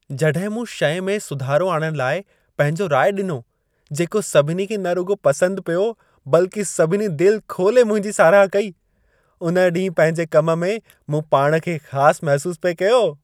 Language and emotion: Sindhi, happy